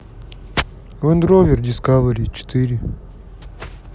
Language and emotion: Russian, sad